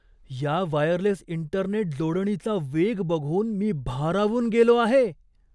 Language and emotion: Marathi, surprised